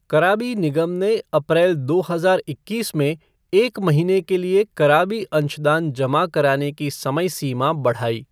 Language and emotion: Hindi, neutral